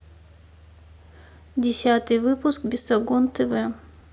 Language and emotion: Russian, neutral